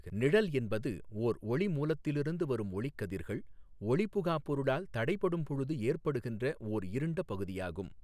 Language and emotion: Tamil, neutral